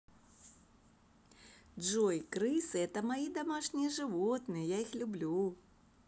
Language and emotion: Russian, positive